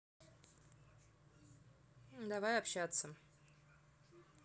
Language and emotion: Russian, neutral